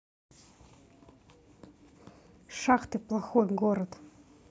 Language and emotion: Russian, angry